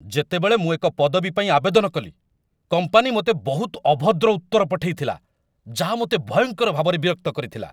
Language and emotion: Odia, angry